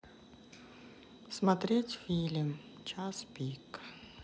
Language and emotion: Russian, sad